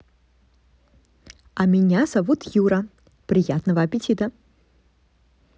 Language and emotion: Russian, positive